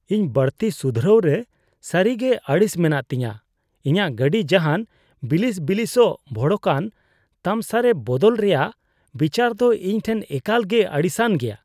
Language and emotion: Santali, disgusted